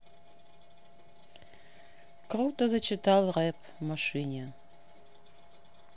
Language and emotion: Russian, neutral